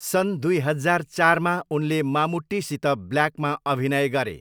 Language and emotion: Nepali, neutral